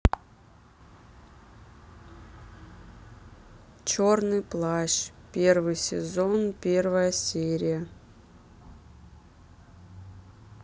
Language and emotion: Russian, neutral